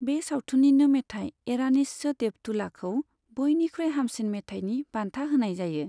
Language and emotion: Bodo, neutral